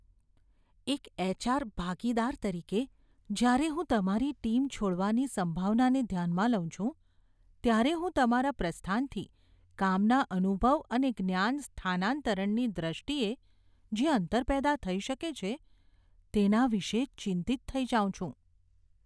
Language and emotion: Gujarati, fearful